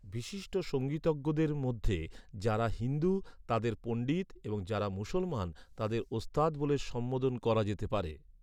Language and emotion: Bengali, neutral